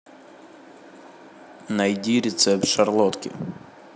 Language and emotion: Russian, neutral